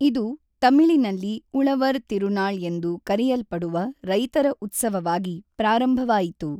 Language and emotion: Kannada, neutral